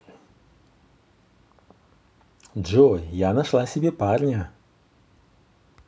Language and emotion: Russian, positive